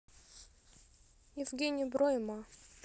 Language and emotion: Russian, neutral